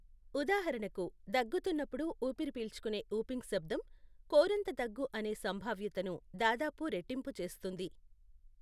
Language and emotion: Telugu, neutral